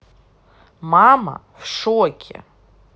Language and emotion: Russian, angry